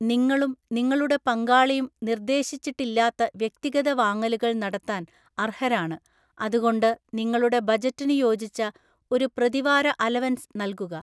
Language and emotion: Malayalam, neutral